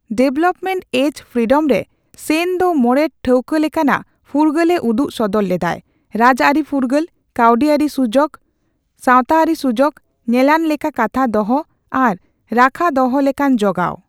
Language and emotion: Santali, neutral